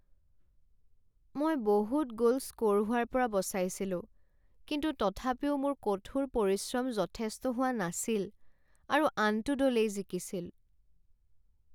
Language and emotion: Assamese, sad